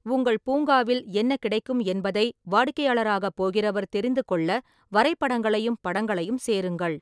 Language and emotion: Tamil, neutral